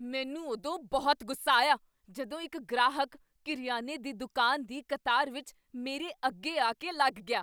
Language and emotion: Punjabi, angry